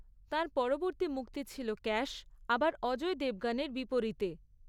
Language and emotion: Bengali, neutral